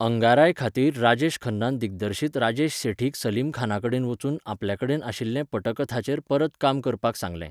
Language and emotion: Goan Konkani, neutral